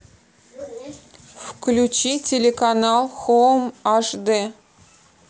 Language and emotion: Russian, neutral